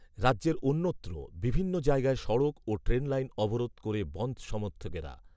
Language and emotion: Bengali, neutral